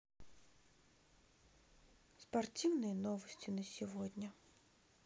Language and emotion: Russian, neutral